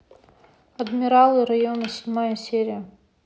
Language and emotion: Russian, neutral